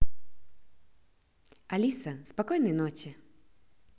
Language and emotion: Russian, positive